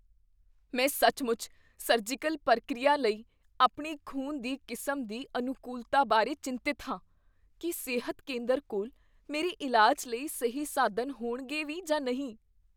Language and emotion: Punjabi, fearful